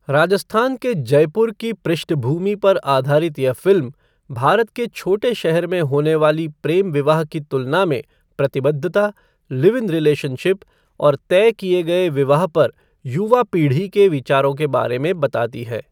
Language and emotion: Hindi, neutral